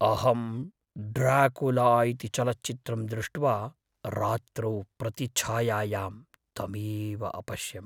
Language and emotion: Sanskrit, fearful